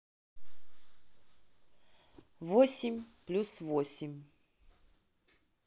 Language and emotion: Russian, neutral